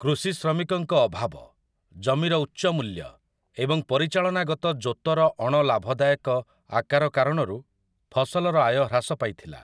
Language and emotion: Odia, neutral